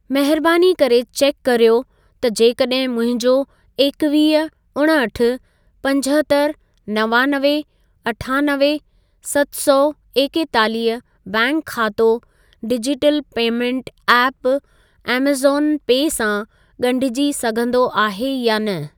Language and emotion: Sindhi, neutral